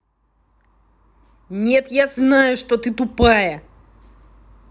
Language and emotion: Russian, angry